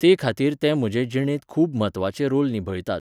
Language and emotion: Goan Konkani, neutral